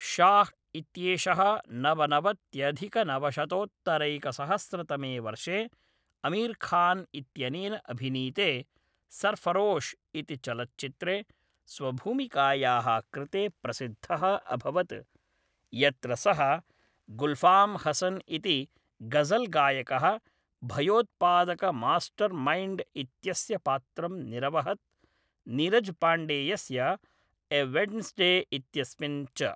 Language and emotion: Sanskrit, neutral